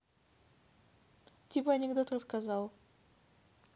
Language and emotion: Russian, neutral